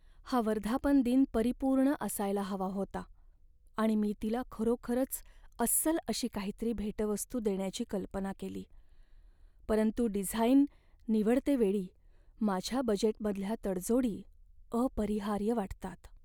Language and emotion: Marathi, sad